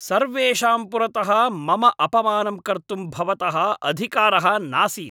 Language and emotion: Sanskrit, angry